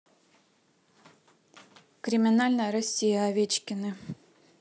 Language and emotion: Russian, neutral